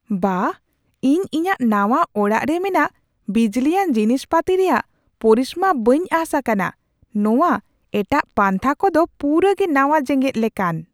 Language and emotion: Santali, surprised